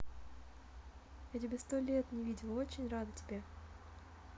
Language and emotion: Russian, positive